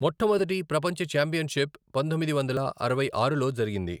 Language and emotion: Telugu, neutral